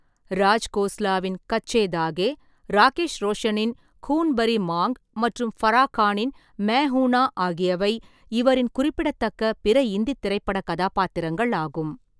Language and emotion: Tamil, neutral